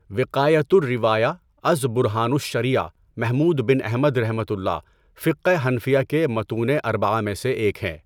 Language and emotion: Urdu, neutral